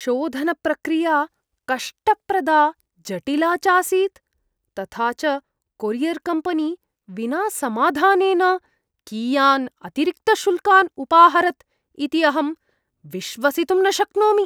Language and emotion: Sanskrit, disgusted